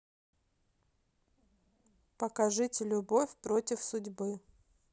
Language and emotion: Russian, neutral